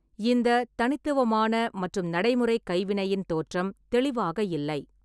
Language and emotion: Tamil, neutral